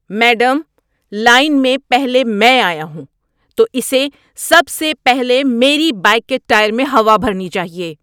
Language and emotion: Urdu, angry